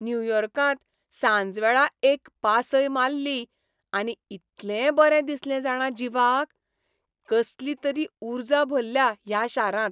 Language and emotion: Goan Konkani, happy